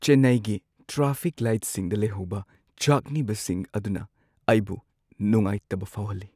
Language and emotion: Manipuri, sad